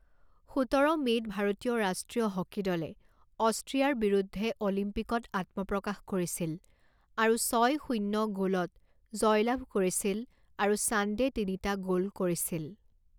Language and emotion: Assamese, neutral